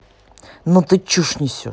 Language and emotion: Russian, angry